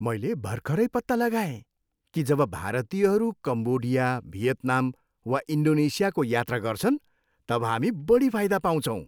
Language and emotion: Nepali, happy